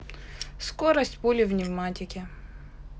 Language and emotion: Russian, neutral